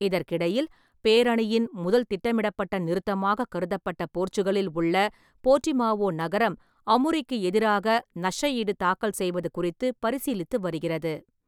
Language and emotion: Tamil, neutral